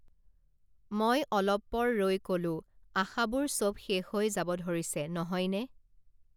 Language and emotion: Assamese, neutral